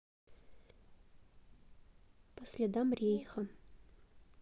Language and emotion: Russian, neutral